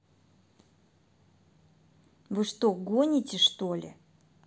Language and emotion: Russian, angry